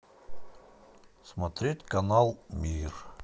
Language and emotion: Russian, neutral